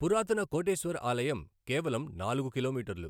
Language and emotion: Telugu, neutral